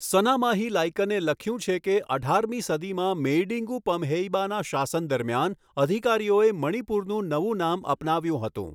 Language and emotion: Gujarati, neutral